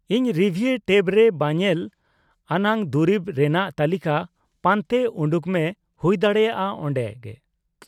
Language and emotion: Santali, neutral